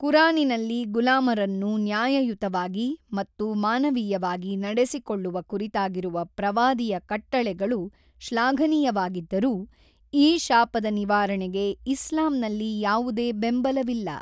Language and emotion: Kannada, neutral